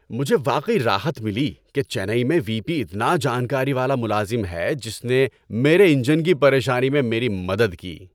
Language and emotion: Urdu, happy